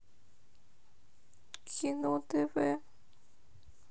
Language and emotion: Russian, sad